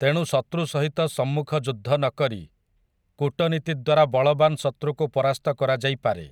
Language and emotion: Odia, neutral